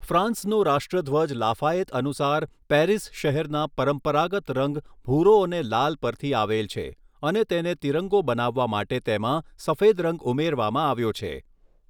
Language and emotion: Gujarati, neutral